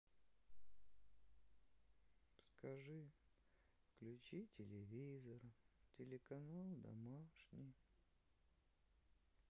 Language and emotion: Russian, sad